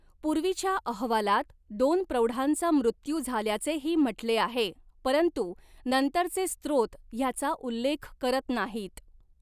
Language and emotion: Marathi, neutral